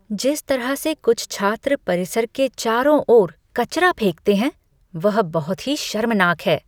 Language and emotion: Hindi, disgusted